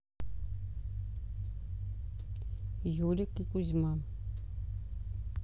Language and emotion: Russian, neutral